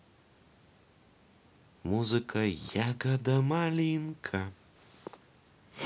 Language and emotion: Russian, positive